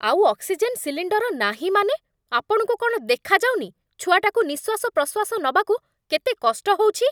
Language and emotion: Odia, angry